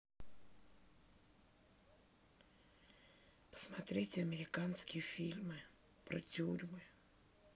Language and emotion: Russian, sad